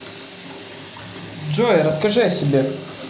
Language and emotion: Russian, neutral